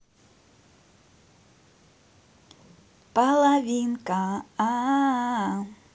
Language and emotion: Russian, positive